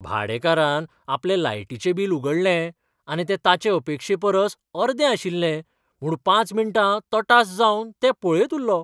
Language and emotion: Goan Konkani, surprised